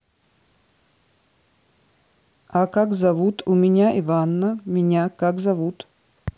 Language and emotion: Russian, neutral